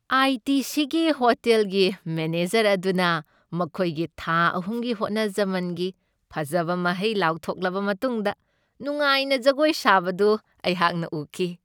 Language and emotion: Manipuri, happy